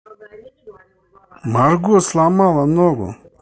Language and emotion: Russian, angry